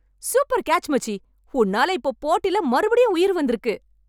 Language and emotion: Tamil, happy